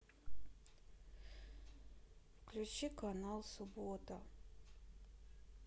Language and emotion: Russian, sad